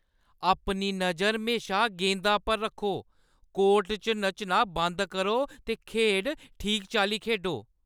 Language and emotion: Dogri, angry